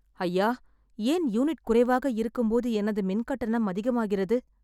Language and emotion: Tamil, sad